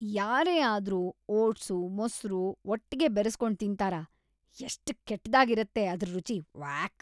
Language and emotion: Kannada, disgusted